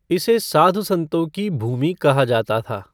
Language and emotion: Hindi, neutral